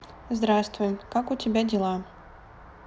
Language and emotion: Russian, neutral